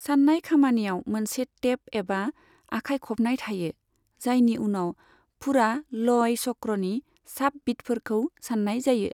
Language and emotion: Bodo, neutral